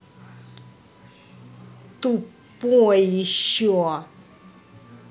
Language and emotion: Russian, angry